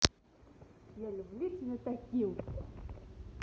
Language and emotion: Russian, positive